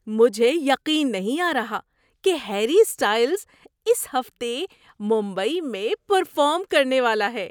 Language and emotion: Urdu, surprised